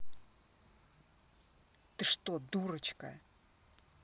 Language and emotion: Russian, angry